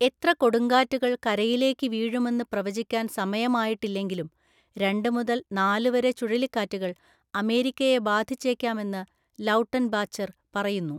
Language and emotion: Malayalam, neutral